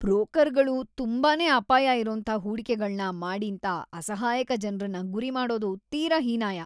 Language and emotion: Kannada, disgusted